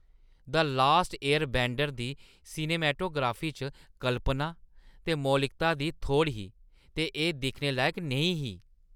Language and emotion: Dogri, disgusted